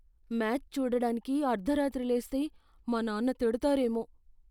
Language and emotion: Telugu, fearful